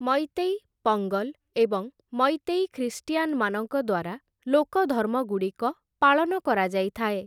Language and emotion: Odia, neutral